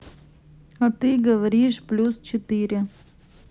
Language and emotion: Russian, neutral